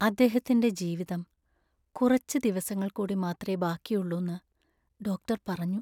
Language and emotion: Malayalam, sad